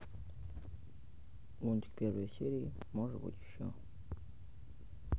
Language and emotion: Russian, neutral